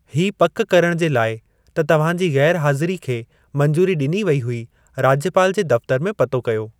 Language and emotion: Sindhi, neutral